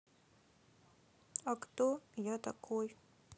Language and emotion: Russian, sad